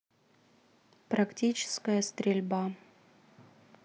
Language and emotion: Russian, neutral